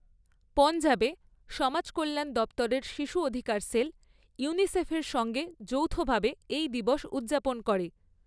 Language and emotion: Bengali, neutral